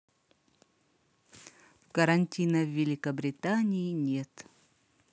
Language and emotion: Russian, neutral